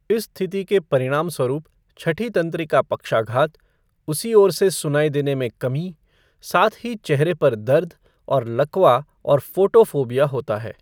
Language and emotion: Hindi, neutral